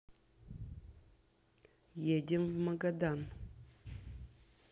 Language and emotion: Russian, neutral